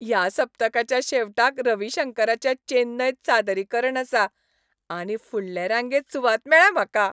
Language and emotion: Goan Konkani, happy